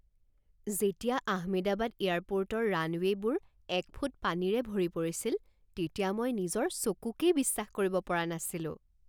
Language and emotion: Assamese, surprised